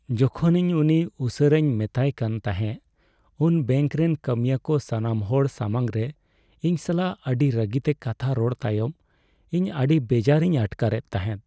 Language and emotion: Santali, sad